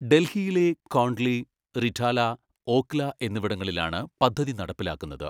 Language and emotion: Malayalam, neutral